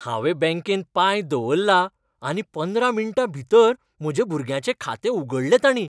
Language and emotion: Goan Konkani, happy